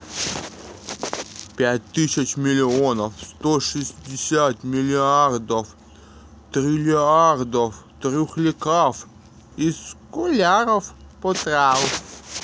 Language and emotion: Russian, positive